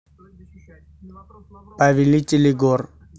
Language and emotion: Russian, neutral